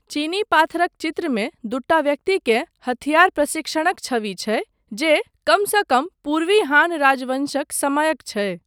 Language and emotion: Maithili, neutral